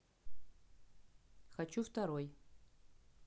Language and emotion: Russian, neutral